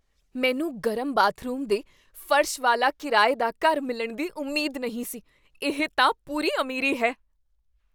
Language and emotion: Punjabi, surprised